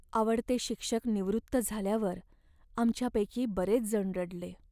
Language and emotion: Marathi, sad